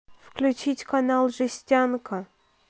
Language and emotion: Russian, neutral